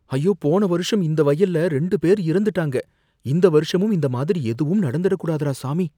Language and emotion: Tamil, fearful